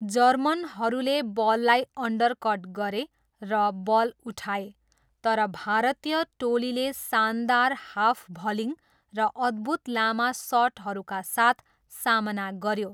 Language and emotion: Nepali, neutral